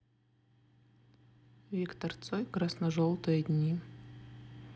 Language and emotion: Russian, neutral